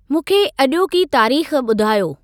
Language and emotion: Sindhi, neutral